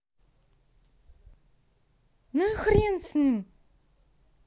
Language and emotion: Russian, angry